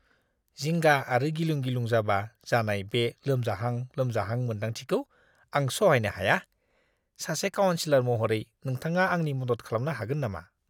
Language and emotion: Bodo, disgusted